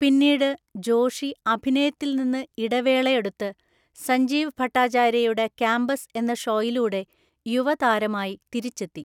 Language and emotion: Malayalam, neutral